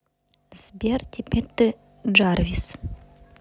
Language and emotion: Russian, neutral